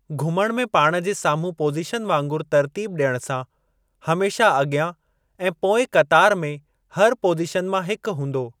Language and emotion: Sindhi, neutral